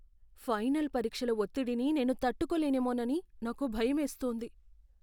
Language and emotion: Telugu, fearful